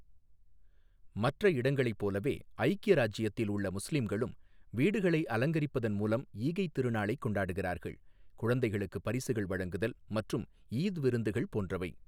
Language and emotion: Tamil, neutral